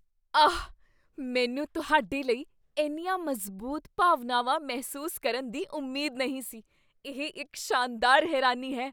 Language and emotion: Punjabi, surprised